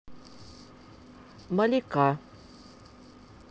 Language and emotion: Russian, neutral